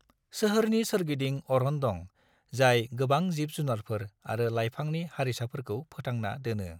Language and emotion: Bodo, neutral